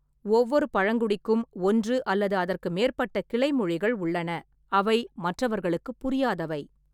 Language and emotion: Tamil, neutral